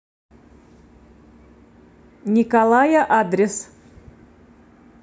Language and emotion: Russian, neutral